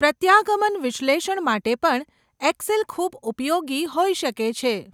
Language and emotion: Gujarati, neutral